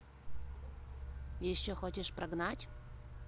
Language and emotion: Russian, neutral